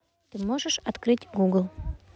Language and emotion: Russian, neutral